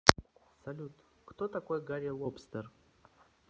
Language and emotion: Russian, neutral